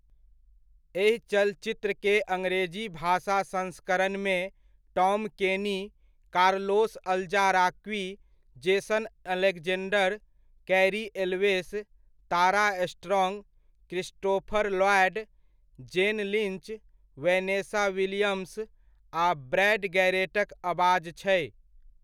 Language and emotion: Maithili, neutral